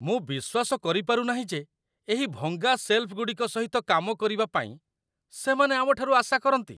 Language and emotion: Odia, disgusted